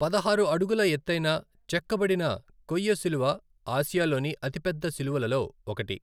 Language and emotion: Telugu, neutral